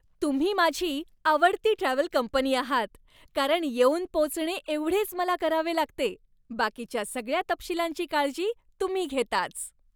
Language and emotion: Marathi, happy